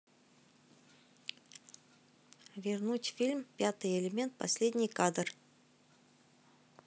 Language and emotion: Russian, neutral